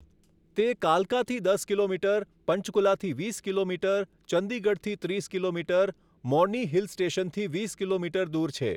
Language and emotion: Gujarati, neutral